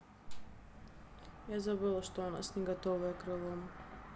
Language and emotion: Russian, sad